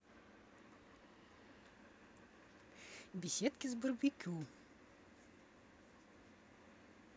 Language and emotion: Russian, neutral